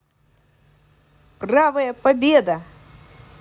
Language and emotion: Russian, positive